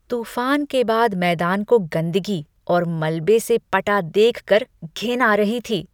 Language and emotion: Hindi, disgusted